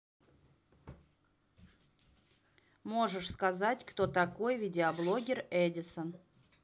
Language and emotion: Russian, neutral